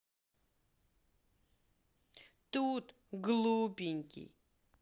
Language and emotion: Russian, neutral